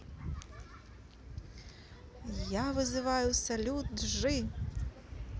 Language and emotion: Russian, positive